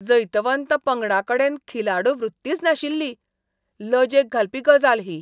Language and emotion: Goan Konkani, disgusted